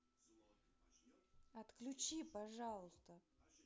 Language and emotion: Russian, neutral